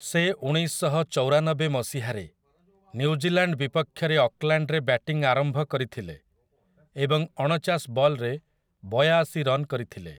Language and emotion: Odia, neutral